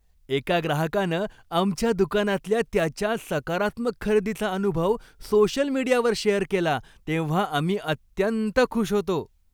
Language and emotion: Marathi, happy